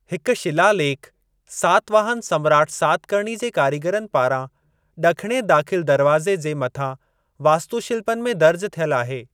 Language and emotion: Sindhi, neutral